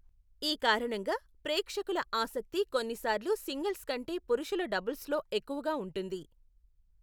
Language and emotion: Telugu, neutral